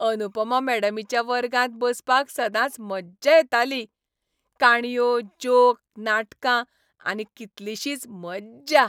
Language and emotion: Goan Konkani, happy